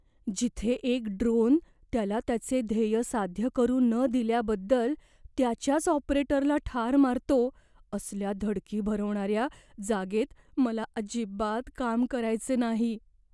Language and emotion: Marathi, fearful